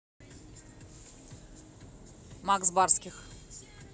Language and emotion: Russian, neutral